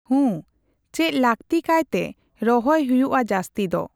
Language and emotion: Santali, neutral